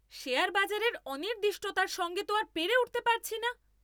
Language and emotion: Bengali, angry